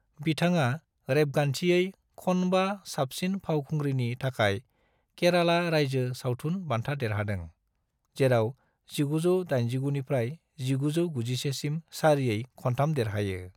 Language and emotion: Bodo, neutral